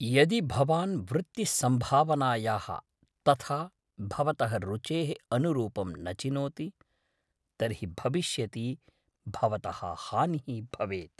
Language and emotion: Sanskrit, fearful